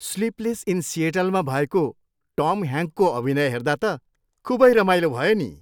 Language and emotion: Nepali, happy